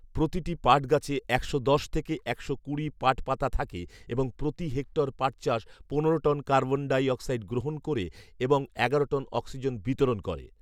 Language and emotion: Bengali, neutral